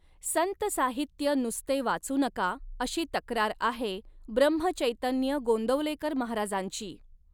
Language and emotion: Marathi, neutral